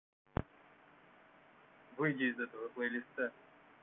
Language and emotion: Russian, neutral